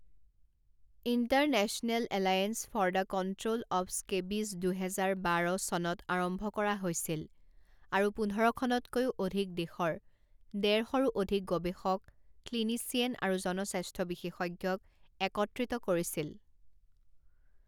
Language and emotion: Assamese, neutral